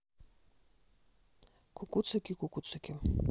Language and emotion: Russian, neutral